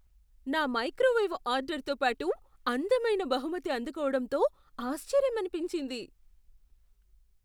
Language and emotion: Telugu, surprised